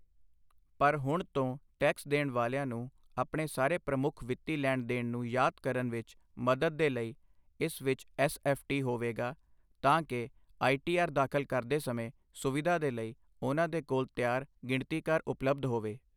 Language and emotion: Punjabi, neutral